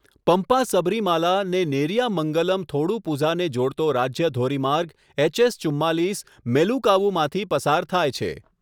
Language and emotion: Gujarati, neutral